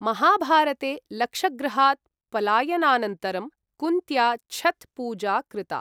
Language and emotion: Sanskrit, neutral